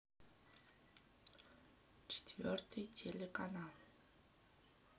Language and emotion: Russian, sad